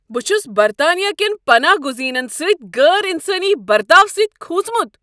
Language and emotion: Kashmiri, angry